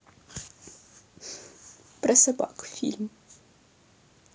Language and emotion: Russian, sad